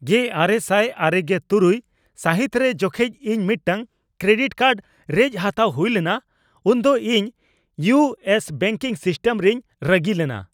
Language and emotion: Santali, angry